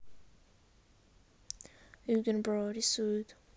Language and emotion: Russian, neutral